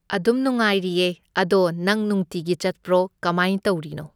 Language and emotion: Manipuri, neutral